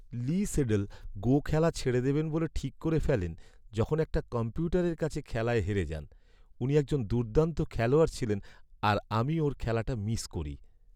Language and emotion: Bengali, sad